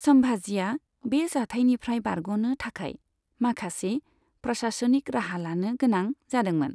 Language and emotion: Bodo, neutral